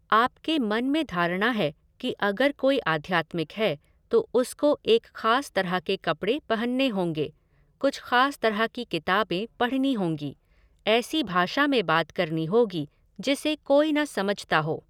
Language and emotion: Hindi, neutral